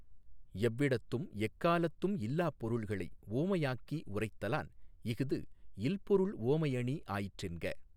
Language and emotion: Tamil, neutral